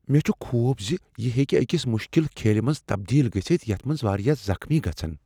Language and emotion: Kashmiri, fearful